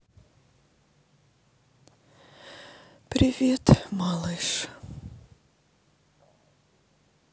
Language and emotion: Russian, sad